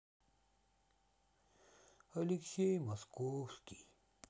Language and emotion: Russian, sad